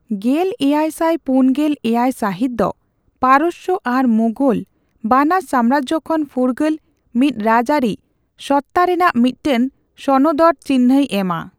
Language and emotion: Santali, neutral